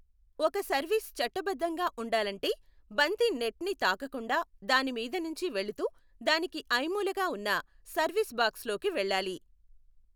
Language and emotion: Telugu, neutral